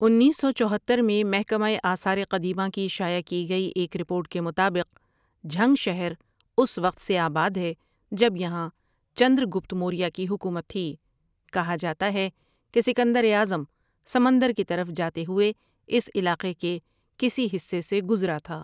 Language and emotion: Urdu, neutral